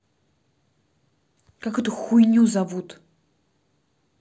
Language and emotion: Russian, angry